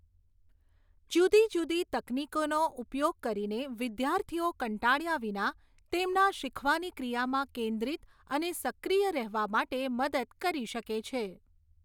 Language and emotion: Gujarati, neutral